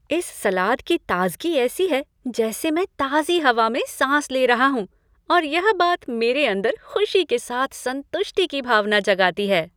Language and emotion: Hindi, happy